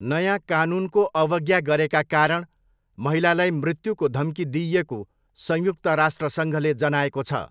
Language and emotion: Nepali, neutral